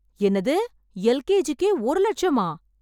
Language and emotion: Tamil, surprised